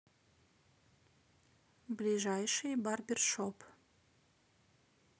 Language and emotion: Russian, neutral